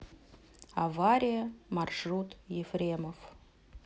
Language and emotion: Russian, neutral